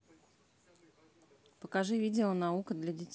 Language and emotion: Russian, neutral